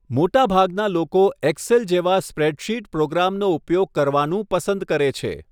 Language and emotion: Gujarati, neutral